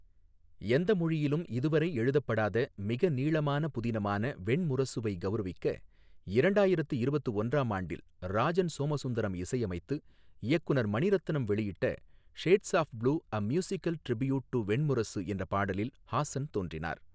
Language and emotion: Tamil, neutral